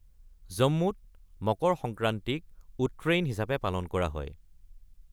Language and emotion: Assamese, neutral